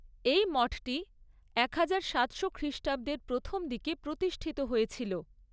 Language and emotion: Bengali, neutral